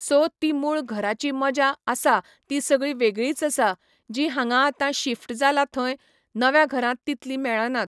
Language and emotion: Goan Konkani, neutral